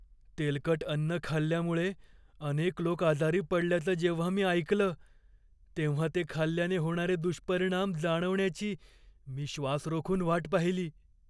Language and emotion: Marathi, fearful